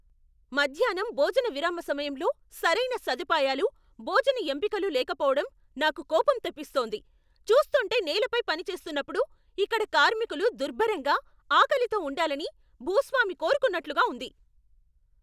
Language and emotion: Telugu, angry